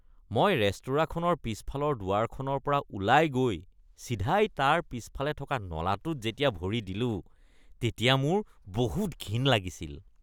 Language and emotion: Assamese, disgusted